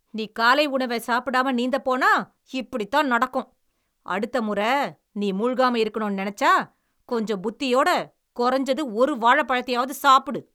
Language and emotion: Tamil, angry